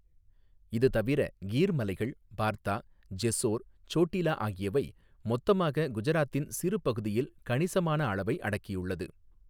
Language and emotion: Tamil, neutral